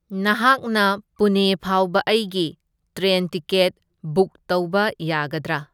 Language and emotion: Manipuri, neutral